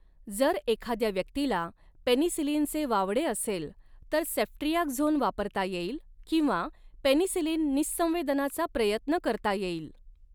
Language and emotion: Marathi, neutral